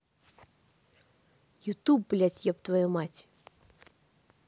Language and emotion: Russian, angry